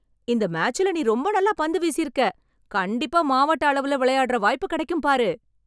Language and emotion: Tamil, happy